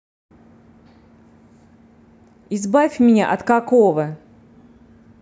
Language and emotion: Russian, angry